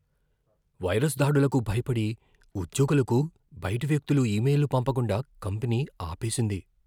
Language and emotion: Telugu, fearful